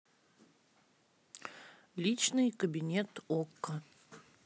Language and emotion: Russian, neutral